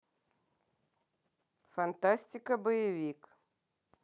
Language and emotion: Russian, neutral